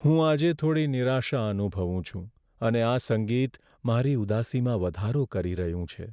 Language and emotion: Gujarati, sad